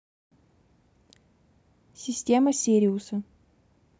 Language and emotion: Russian, neutral